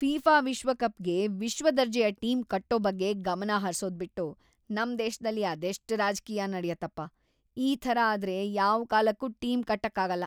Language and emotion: Kannada, disgusted